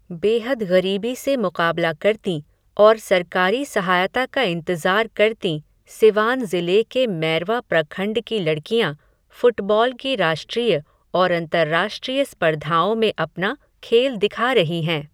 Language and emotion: Hindi, neutral